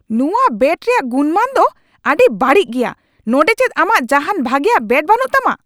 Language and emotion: Santali, angry